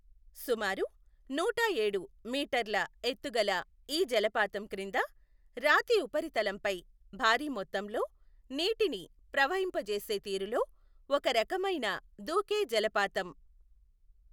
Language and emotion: Telugu, neutral